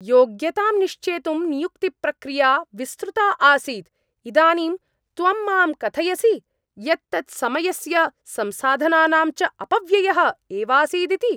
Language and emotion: Sanskrit, angry